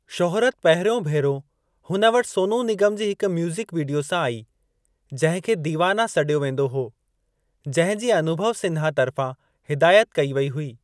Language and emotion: Sindhi, neutral